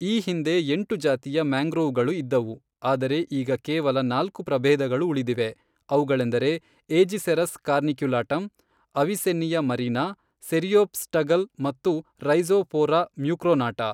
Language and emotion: Kannada, neutral